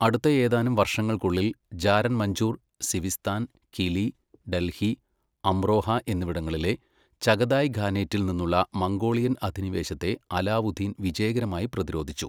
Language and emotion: Malayalam, neutral